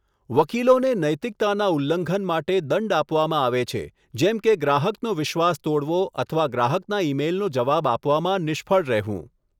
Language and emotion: Gujarati, neutral